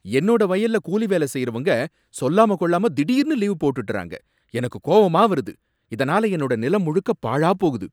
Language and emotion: Tamil, angry